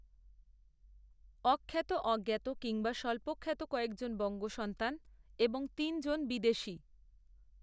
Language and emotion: Bengali, neutral